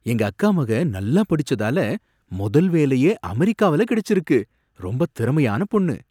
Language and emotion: Tamil, surprised